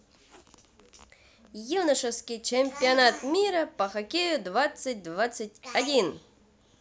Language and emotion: Russian, positive